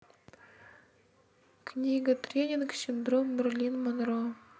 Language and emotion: Russian, neutral